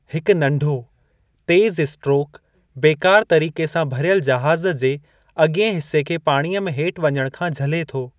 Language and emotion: Sindhi, neutral